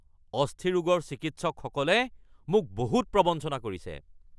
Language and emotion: Assamese, angry